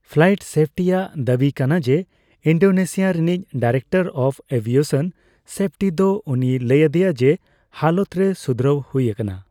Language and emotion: Santali, neutral